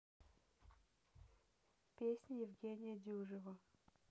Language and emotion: Russian, neutral